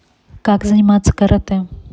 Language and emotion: Russian, neutral